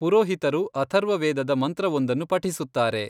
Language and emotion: Kannada, neutral